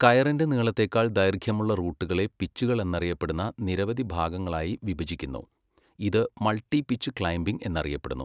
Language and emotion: Malayalam, neutral